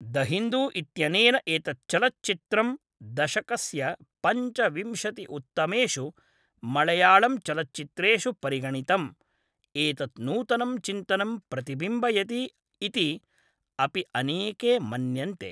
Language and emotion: Sanskrit, neutral